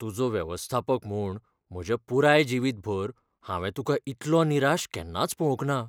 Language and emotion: Goan Konkani, fearful